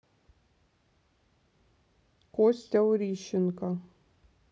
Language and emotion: Russian, neutral